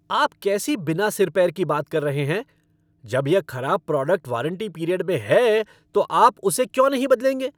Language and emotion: Hindi, angry